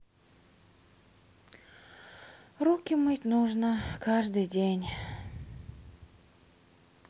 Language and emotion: Russian, sad